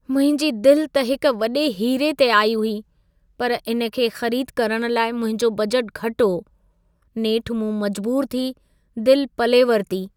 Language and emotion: Sindhi, sad